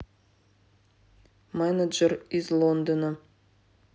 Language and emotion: Russian, neutral